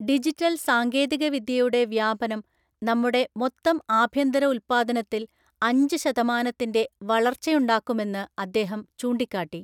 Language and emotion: Malayalam, neutral